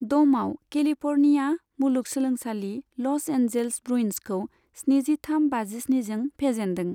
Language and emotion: Bodo, neutral